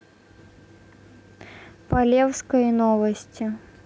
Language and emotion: Russian, neutral